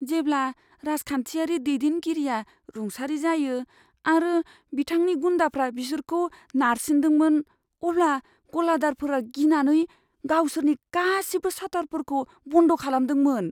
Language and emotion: Bodo, fearful